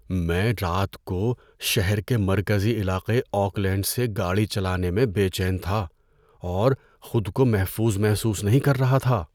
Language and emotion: Urdu, fearful